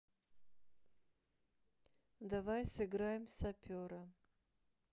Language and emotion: Russian, neutral